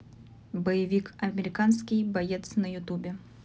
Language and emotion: Russian, neutral